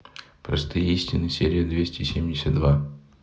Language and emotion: Russian, neutral